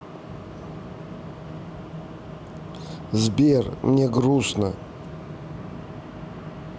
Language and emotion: Russian, sad